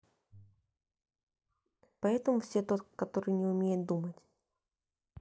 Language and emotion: Russian, neutral